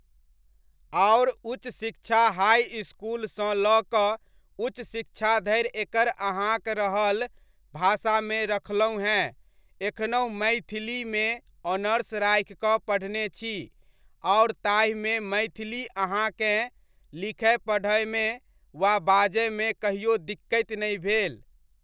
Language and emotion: Maithili, neutral